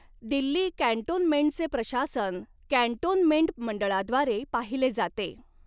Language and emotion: Marathi, neutral